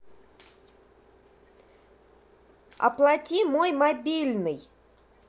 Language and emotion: Russian, angry